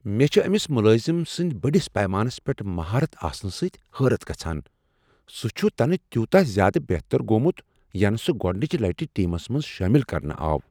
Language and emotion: Kashmiri, surprised